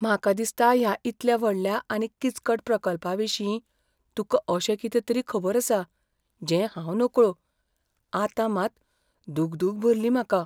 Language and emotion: Goan Konkani, fearful